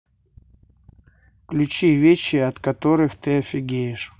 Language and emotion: Russian, neutral